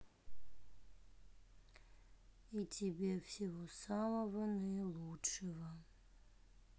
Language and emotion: Russian, sad